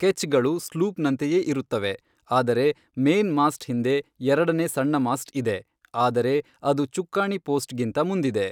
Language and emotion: Kannada, neutral